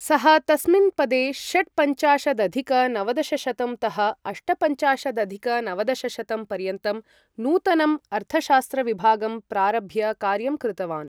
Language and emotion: Sanskrit, neutral